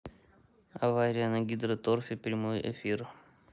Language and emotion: Russian, neutral